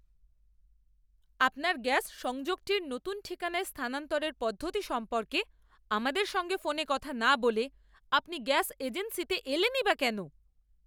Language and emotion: Bengali, angry